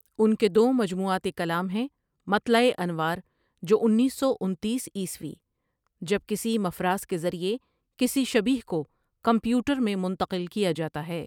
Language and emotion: Urdu, neutral